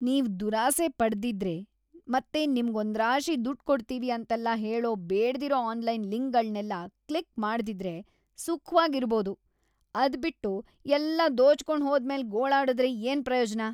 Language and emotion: Kannada, disgusted